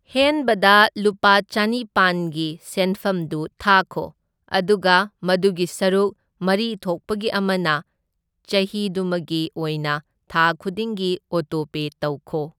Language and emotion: Manipuri, neutral